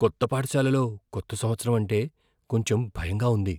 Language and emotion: Telugu, fearful